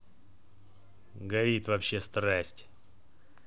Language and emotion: Russian, neutral